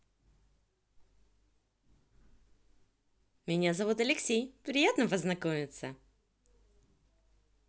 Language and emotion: Russian, positive